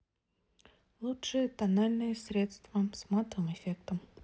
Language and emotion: Russian, neutral